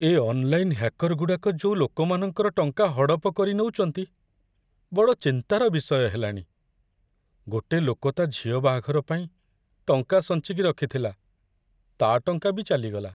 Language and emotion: Odia, sad